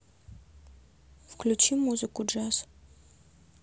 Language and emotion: Russian, neutral